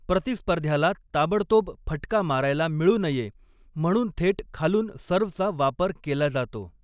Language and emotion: Marathi, neutral